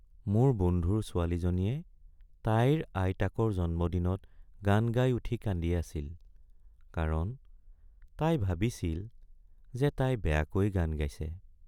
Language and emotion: Assamese, sad